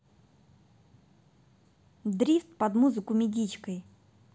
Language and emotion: Russian, neutral